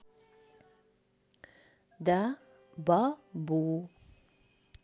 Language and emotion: Russian, neutral